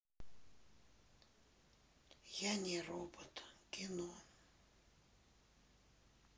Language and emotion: Russian, sad